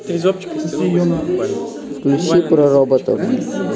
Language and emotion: Russian, neutral